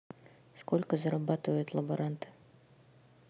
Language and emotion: Russian, neutral